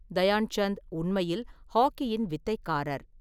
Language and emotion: Tamil, neutral